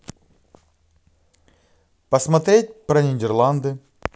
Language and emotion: Russian, positive